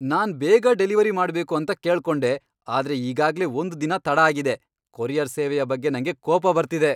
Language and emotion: Kannada, angry